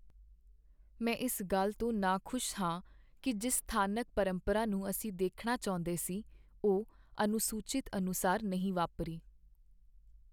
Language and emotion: Punjabi, sad